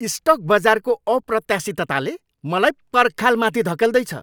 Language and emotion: Nepali, angry